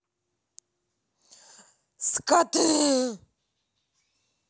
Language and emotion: Russian, angry